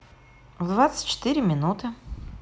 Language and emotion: Russian, positive